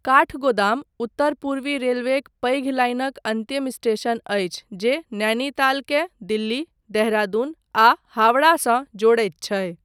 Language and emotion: Maithili, neutral